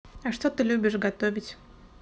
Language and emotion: Russian, neutral